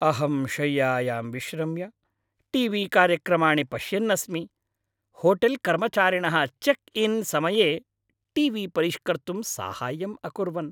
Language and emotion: Sanskrit, happy